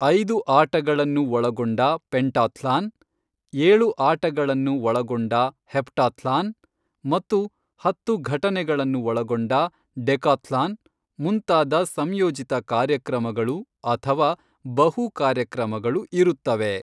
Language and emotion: Kannada, neutral